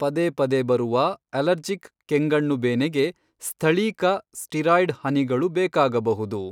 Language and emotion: Kannada, neutral